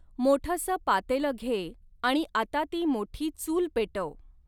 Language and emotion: Marathi, neutral